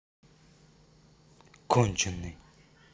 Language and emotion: Russian, angry